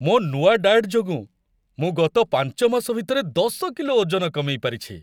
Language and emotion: Odia, happy